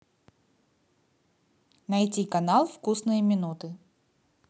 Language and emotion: Russian, neutral